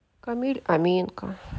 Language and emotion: Russian, sad